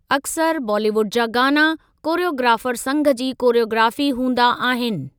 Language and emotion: Sindhi, neutral